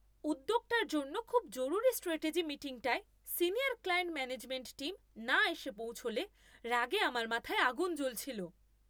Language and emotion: Bengali, angry